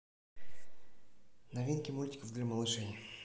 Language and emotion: Russian, neutral